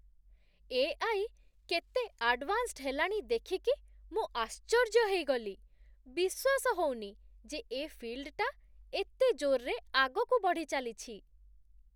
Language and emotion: Odia, surprised